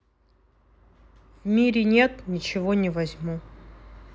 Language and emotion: Russian, neutral